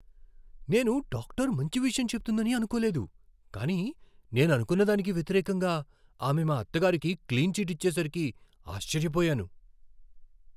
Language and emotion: Telugu, surprised